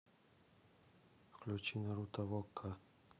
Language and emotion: Russian, neutral